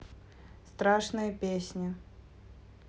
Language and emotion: Russian, neutral